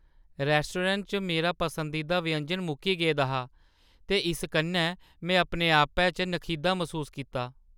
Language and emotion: Dogri, sad